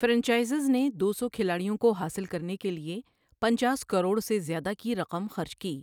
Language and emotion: Urdu, neutral